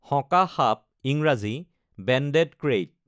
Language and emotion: Assamese, neutral